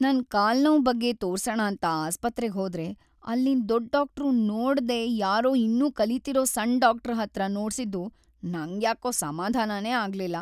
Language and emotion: Kannada, sad